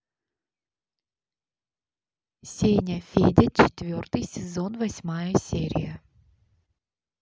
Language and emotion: Russian, neutral